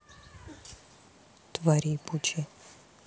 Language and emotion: Russian, neutral